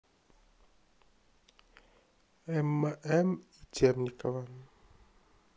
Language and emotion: Russian, neutral